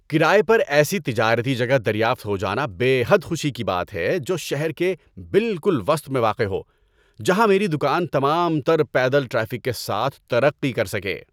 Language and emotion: Urdu, happy